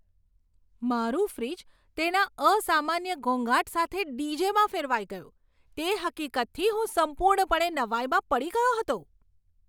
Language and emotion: Gujarati, surprised